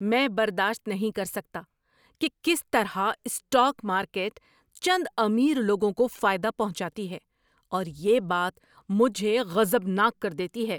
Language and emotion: Urdu, angry